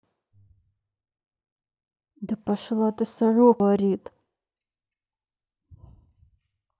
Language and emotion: Russian, angry